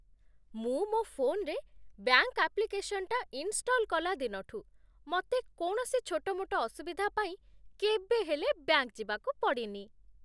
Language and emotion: Odia, happy